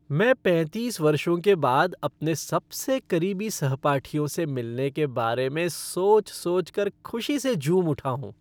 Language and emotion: Hindi, happy